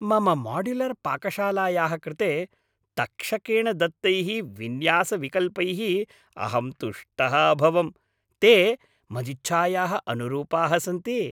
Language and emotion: Sanskrit, happy